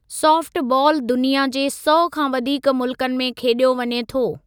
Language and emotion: Sindhi, neutral